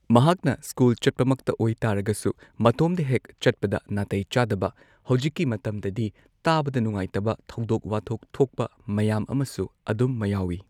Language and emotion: Manipuri, neutral